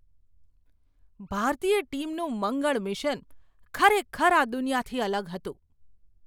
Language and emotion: Gujarati, surprised